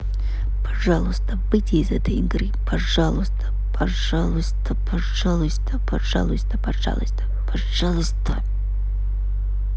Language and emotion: Russian, angry